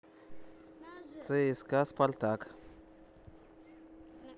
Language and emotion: Russian, neutral